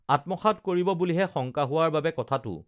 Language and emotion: Assamese, neutral